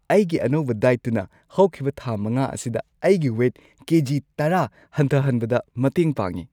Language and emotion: Manipuri, happy